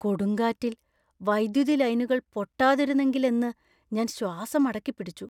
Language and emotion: Malayalam, fearful